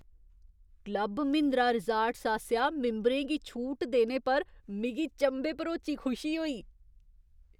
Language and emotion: Dogri, surprised